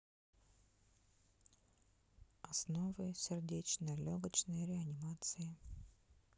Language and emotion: Russian, neutral